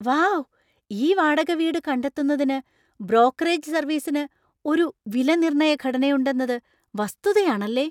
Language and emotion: Malayalam, surprised